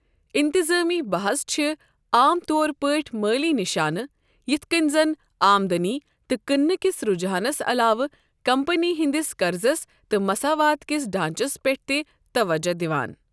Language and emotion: Kashmiri, neutral